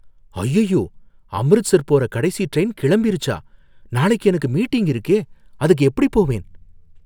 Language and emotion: Tamil, fearful